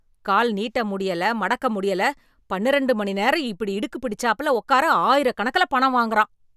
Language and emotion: Tamil, angry